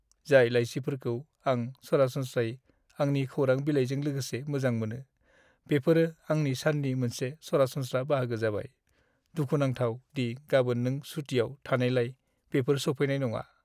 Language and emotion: Bodo, sad